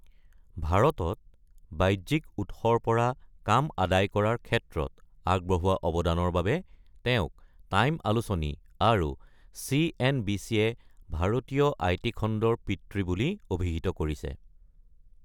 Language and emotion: Assamese, neutral